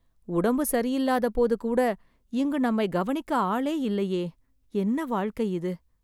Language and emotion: Tamil, sad